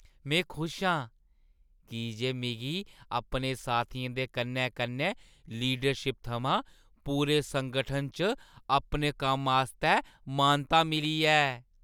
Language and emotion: Dogri, happy